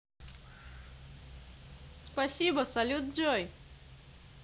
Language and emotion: Russian, positive